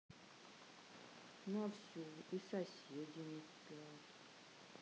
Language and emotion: Russian, neutral